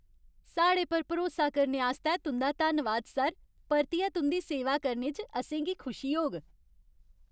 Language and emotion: Dogri, happy